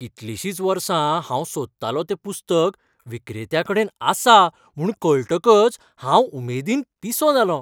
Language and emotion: Goan Konkani, happy